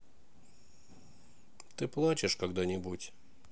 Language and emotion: Russian, sad